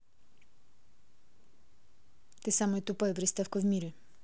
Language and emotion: Russian, angry